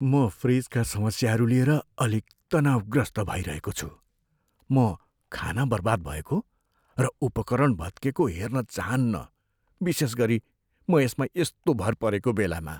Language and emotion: Nepali, fearful